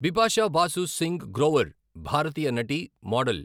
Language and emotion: Telugu, neutral